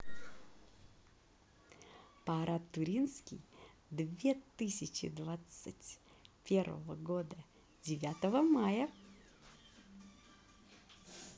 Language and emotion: Russian, positive